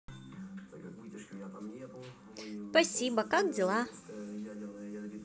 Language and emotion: Russian, positive